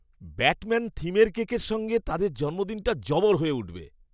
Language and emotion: Bengali, surprised